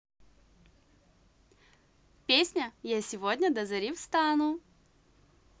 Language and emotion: Russian, positive